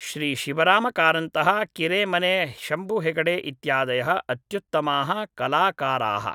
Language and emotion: Sanskrit, neutral